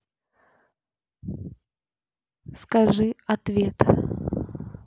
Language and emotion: Russian, neutral